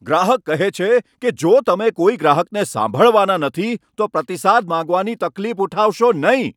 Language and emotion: Gujarati, angry